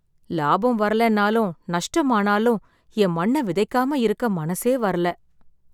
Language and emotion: Tamil, sad